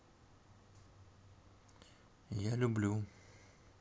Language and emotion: Russian, neutral